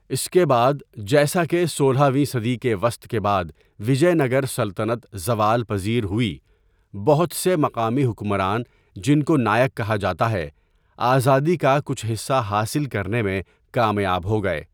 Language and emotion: Urdu, neutral